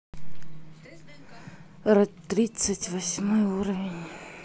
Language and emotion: Russian, sad